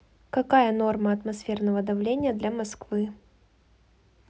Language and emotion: Russian, neutral